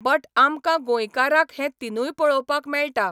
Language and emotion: Goan Konkani, neutral